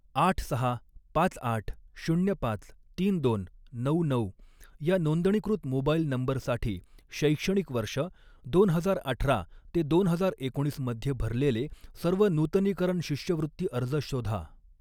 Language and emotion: Marathi, neutral